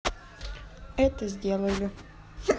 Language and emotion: Russian, neutral